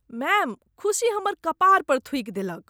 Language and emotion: Maithili, disgusted